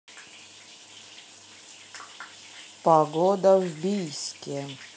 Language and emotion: Russian, neutral